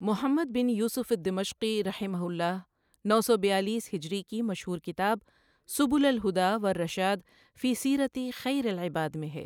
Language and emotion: Urdu, neutral